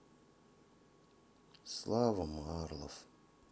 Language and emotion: Russian, sad